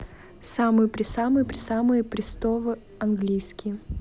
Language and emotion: Russian, neutral